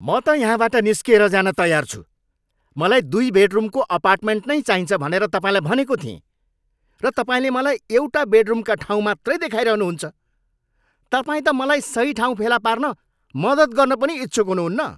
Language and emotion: Nepali, angry